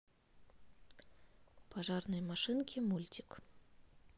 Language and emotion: Russian, neutral